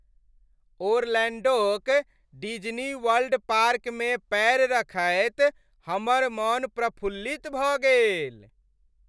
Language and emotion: Maithili, happy